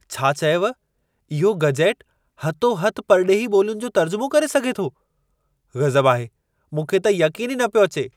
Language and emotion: Sindhi, surprised